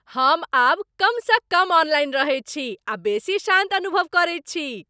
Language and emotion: Maithili, happy